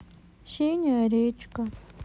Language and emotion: Russian, sad